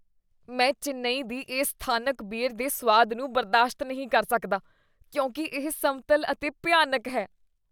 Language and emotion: Punjabi, disgusted